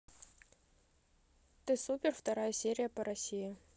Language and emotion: Russian, neutral